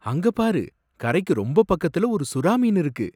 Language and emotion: Tamil, surprised